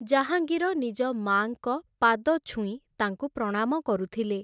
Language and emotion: Odia, neutral